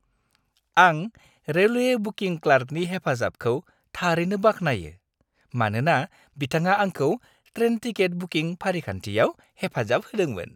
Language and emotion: Bodo, happy